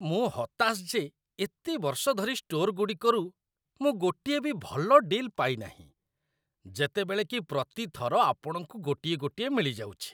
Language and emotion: Odia, disgusted